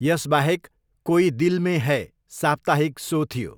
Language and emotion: Nepali, neutral